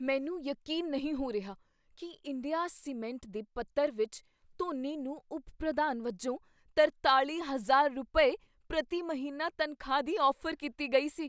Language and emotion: Punjabi, surprised